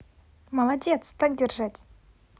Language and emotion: Russian, positive